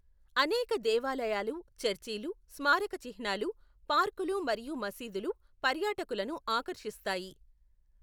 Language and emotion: Telugu, neutral